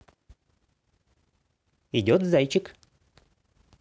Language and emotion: Russian, positive